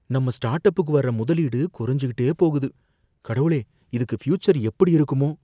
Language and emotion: Tamil, fearful